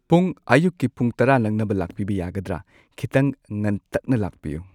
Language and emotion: Manipuri, neutral